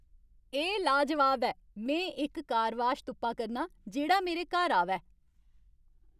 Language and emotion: Dogri, happy